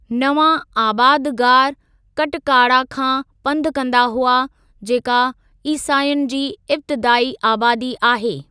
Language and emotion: Sindhi, neutral